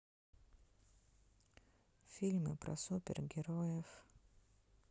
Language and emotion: Russian, sad